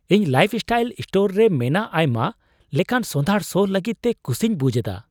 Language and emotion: Santali, surprised